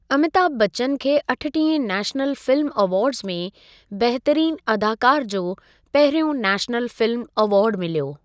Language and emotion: Sindhi, neutral